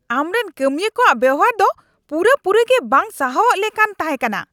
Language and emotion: Santali, angry